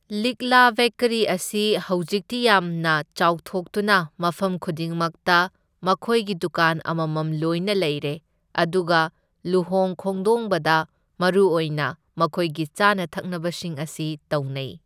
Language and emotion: Manipuri, neutral